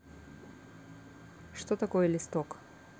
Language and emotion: Russian, neutral